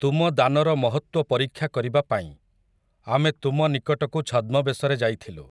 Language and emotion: Odia, neutral